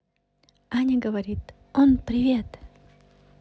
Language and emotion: Russian, positive